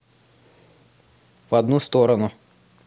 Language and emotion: Russian, neutral